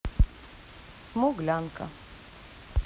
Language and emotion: Russian, neutral